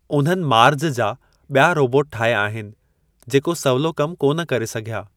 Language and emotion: Sindhi, neutral